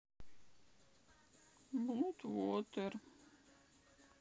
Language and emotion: Russian, sad